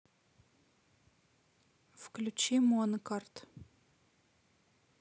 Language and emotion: Russian, neutral